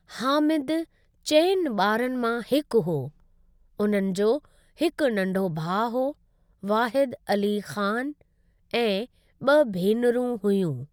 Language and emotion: Sindhi, neutral